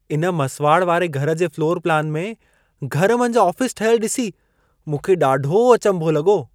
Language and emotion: Sindhi, surprised